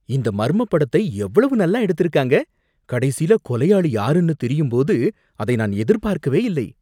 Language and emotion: Tamil, surprised